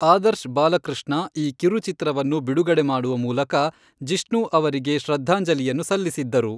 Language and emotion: Kannada, neutral